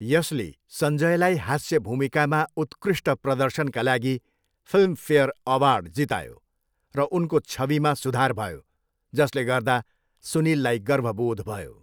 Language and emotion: Nepali, neutral